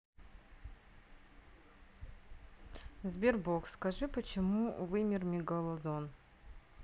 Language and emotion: Russian, neutral